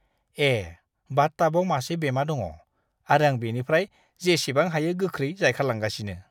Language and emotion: Bodo, disgusted